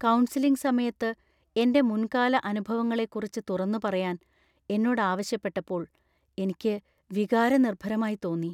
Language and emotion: Malayalam, fearful